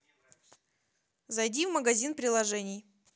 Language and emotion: Russian, neutral